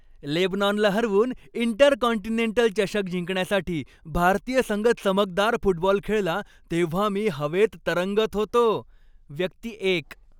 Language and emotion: Marathi, happy